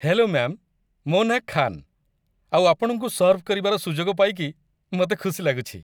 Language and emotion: Odia, happy